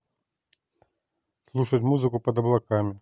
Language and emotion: Russian, neutral